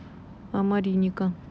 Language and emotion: Russian, neutral